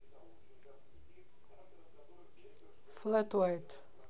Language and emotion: Russian, neutral